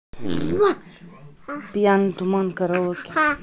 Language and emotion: Russian, neutral